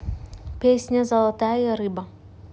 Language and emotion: Russian, neutral